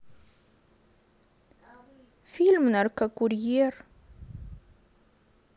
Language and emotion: Russian, sad